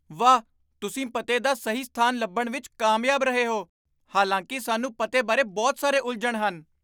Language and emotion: Punjabi, surprised